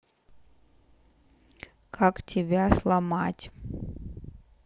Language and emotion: Russian, neutral